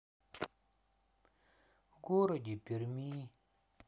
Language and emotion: Russian, sad